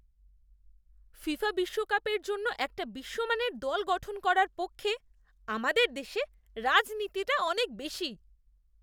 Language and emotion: Bengali, disgusted